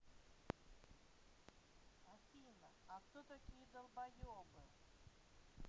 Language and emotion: Russian, neutral